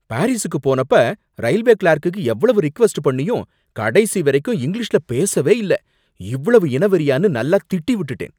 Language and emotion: Tamil, angry